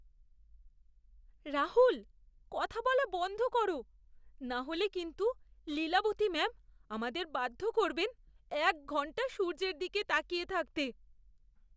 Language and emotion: Bengali, fearful